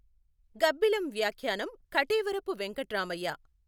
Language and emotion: Telugu, neutral